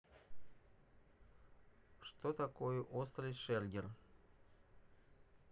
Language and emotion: Russian, neutral